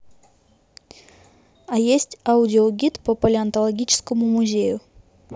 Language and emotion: Russian, neutral